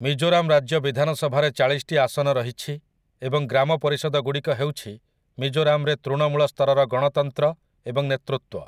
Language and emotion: Odia, neutral